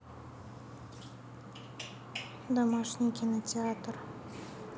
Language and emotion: Russian, neutral